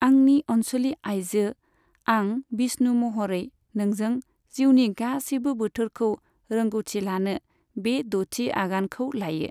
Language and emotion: Bodo, neutral